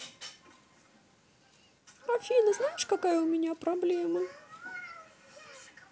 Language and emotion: Russian, sad